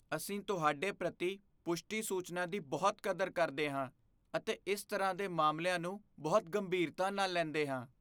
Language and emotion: Punjabi, fearful